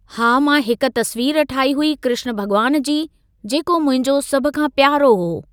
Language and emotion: Sindhi, neutral